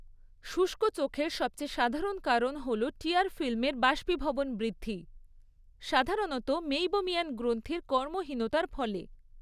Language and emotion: Bengali, neutral